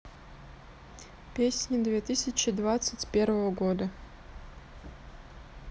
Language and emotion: Russian, neutral